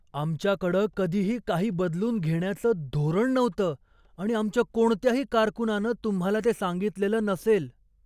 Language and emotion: Marathi, surprised